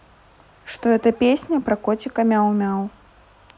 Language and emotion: Russian, neutral